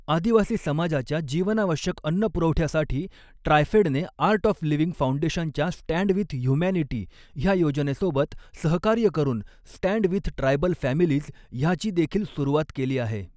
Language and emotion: Marathi, neutral